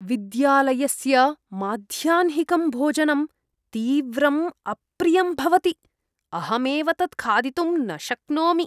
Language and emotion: Sanskrit, disgusted